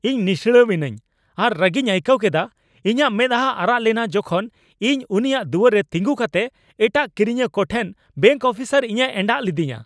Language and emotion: Santali, angry